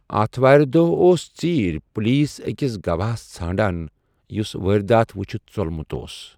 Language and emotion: Kashmiri, neutral